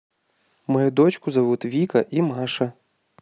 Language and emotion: Russian, neutral